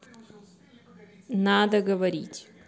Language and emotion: Russian, neutral